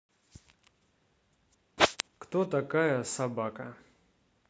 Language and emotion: Russian, neutral